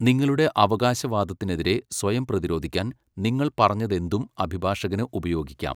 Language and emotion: Malayalam, neutral